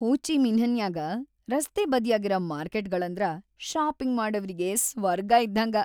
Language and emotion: Kannada, happy